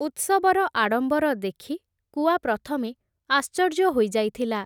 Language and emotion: Odia, neutral